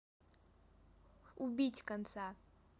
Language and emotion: Russian, neutral